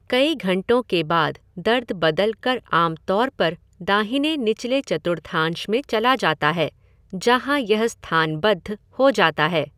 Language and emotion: Hindi, neutral